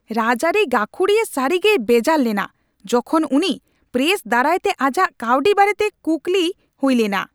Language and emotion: Santali, angry